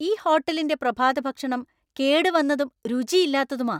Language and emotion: Malayalam, angry